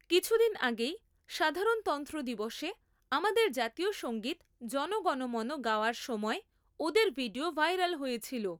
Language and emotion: Bengali, neutral